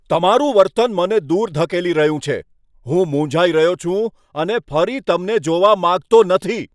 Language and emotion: Gujarati, angry